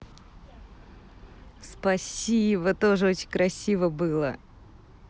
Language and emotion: Russian, positive